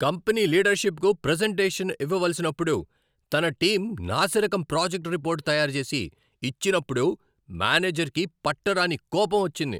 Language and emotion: Telugu, angry